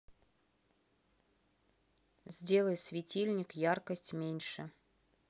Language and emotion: Russian, neutral